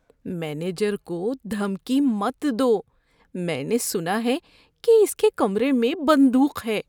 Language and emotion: Urdu, fearful